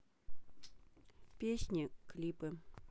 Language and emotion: Russian, neutral